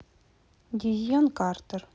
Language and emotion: Russian, neutral